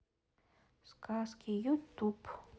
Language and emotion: Russian, neutral